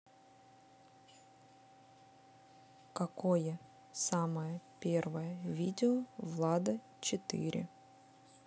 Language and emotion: Russian, neutral